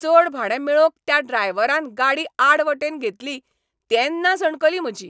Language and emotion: Goan Konkani, angry